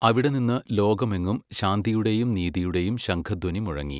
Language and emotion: Malayalam, neutral